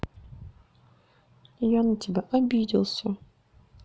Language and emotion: Russian, sad